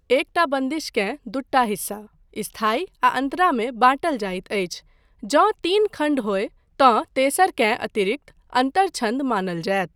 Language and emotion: Maithili, neutral